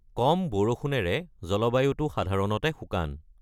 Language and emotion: Assamese, neutral